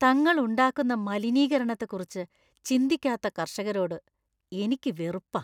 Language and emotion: Malayalam, disgusted